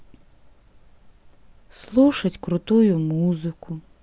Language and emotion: Russian, sad